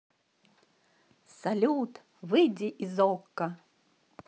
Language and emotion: Russian, positive